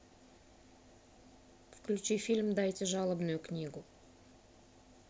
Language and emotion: Russian, neutral